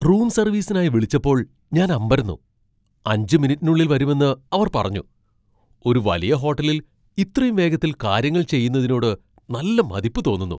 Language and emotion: Malayalam, surprised